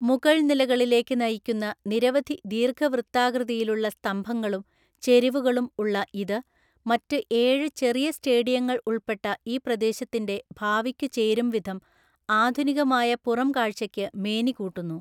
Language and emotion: Malayalam, neutral